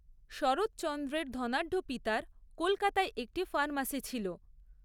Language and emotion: Bengali, neutral